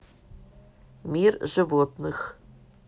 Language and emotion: Russian, neutral